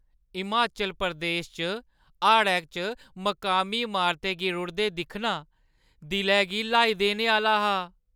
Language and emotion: Dogri, sad